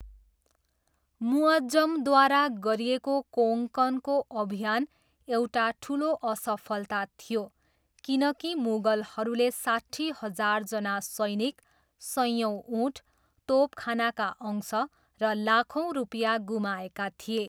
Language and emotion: Nepali, neutral